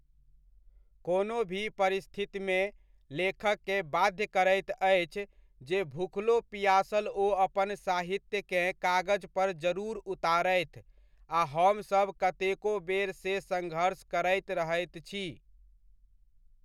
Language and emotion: Maithili, neutral